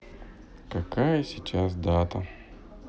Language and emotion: Russian, sad